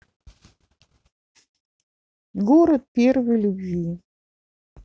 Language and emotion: Russian, neutral